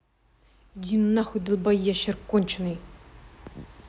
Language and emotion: Russian, angry